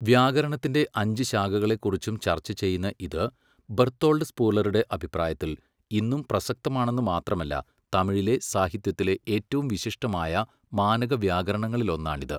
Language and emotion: Malayalam, neutral